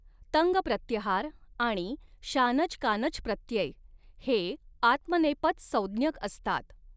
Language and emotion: Marathi, neutral